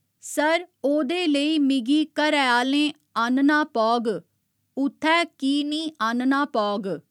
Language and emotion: Dogri, neutral